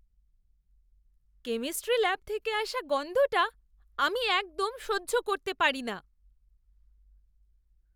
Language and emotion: Bengali, disgusted